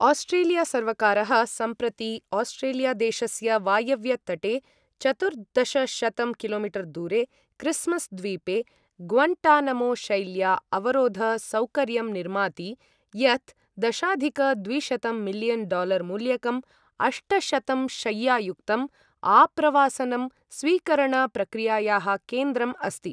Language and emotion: Sanskrit, neutral